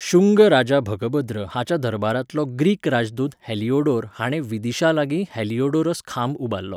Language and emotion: Goan Konkani, neutral